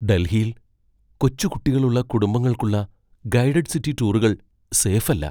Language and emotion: Malayalam, fearful